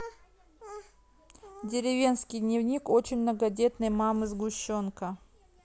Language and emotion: Russian, neutral